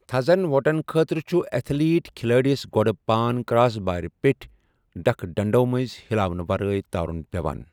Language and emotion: Kashmiri, neutral